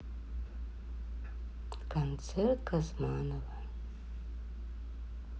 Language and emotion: Russian, sad